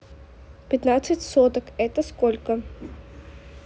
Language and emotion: Russian, neutral